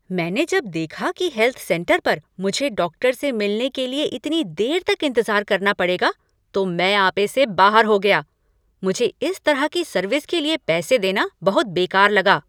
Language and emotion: Hindi, angry